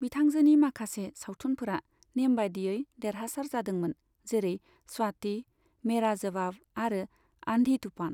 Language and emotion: Bodo, neutral